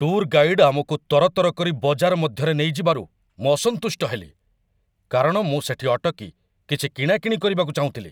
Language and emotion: Odia, angry